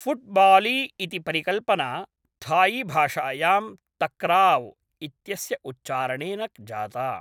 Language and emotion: Sanskrit, neutral